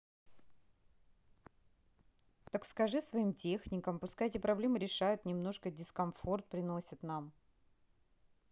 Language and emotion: Russian, neutral